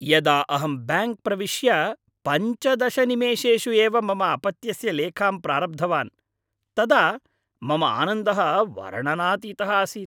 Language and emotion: Sanskrit, happy